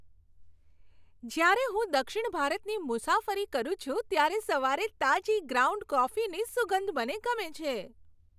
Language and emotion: Gujarati, happy